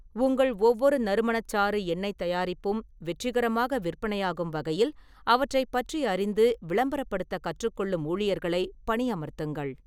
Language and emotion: Tamil, neutral